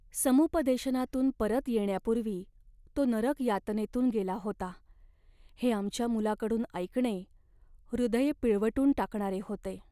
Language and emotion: Marathi, sad